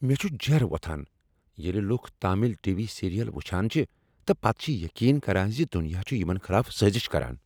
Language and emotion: Kashmiri, angry